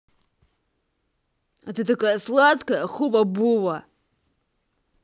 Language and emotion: Russian, angry